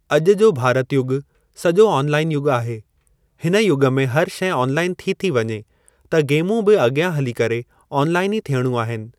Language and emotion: Sindhi, neutral